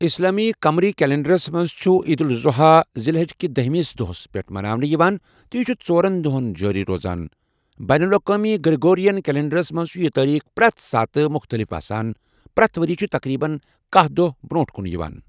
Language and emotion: Kashmiri, neutral